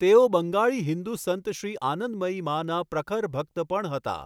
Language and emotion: Gujarati, neutral